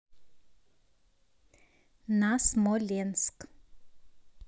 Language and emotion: Russian, neutral